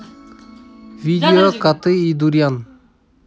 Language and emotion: Russian, neutral